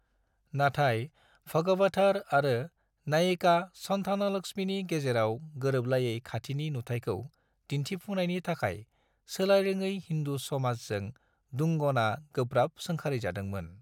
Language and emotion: Bodo, neutral